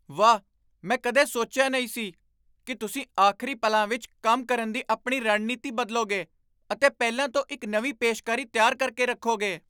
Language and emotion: Punjabi, surprised